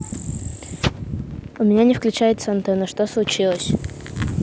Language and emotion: Russian, neutral